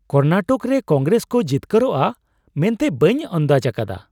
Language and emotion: Santali, surprised